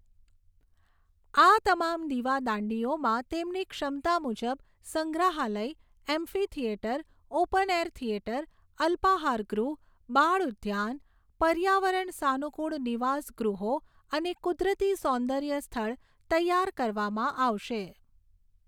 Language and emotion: Gujarati, neutral